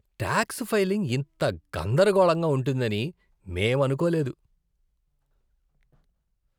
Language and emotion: Telugu, disgusted